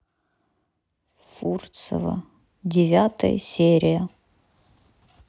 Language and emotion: Russian, neutral